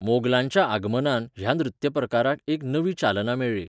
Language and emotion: Goan Konkani, neutral